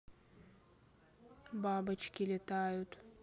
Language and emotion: Russian, neutral